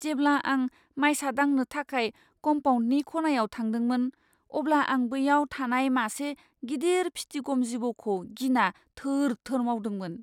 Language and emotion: Bodo, fearful